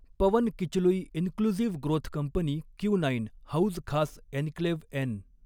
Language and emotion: Marathi, neutral